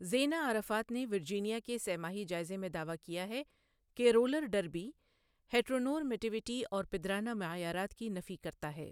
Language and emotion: Urdu, neutral